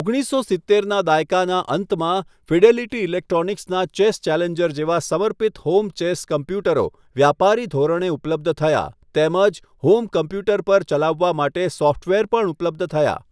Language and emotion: Gujarati, neutral